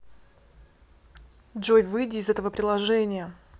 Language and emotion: Russian, neutral